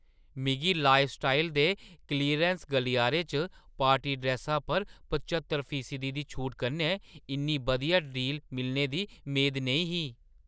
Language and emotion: Dogri, surprised